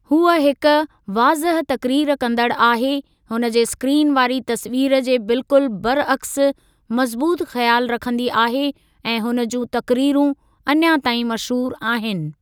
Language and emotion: Sindhi, neutral